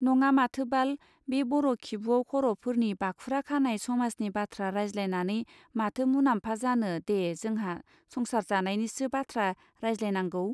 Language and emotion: Bodo, neutral